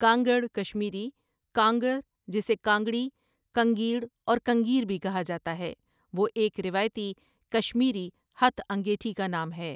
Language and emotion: Urdu, neutral